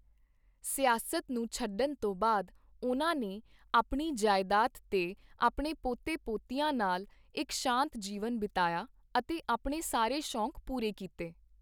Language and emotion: Punjabi, neutral